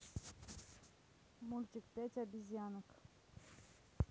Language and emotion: Russian, neutral